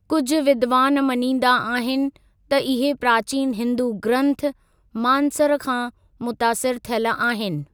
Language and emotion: Sindhi, neutral